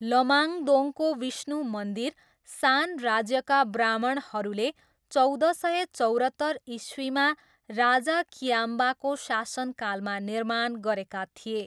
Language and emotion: Nepali, neutral